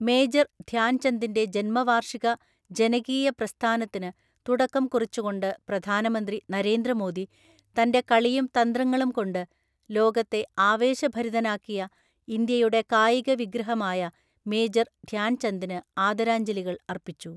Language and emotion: Malayalam, neutral